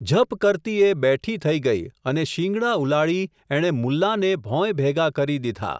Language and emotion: Gujarati, neutral